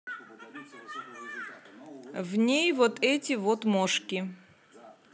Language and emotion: Russian, neutral